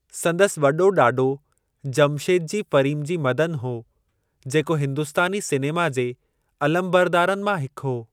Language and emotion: Sindhi, neutral